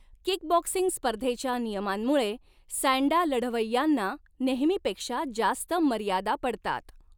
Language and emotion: Marathi, neutral